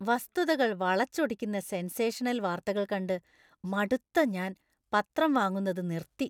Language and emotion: Malayalam, disgusted